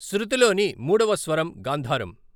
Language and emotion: Telugu, neutral